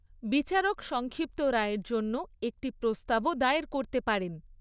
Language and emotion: Bengali, neutral